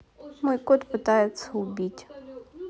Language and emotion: Russian, neutral